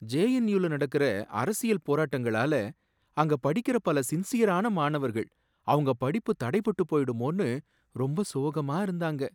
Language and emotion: Tamil, sad